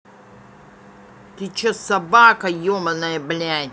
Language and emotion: Russian, angry